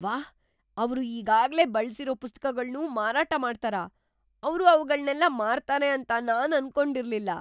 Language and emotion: Kannada, surprised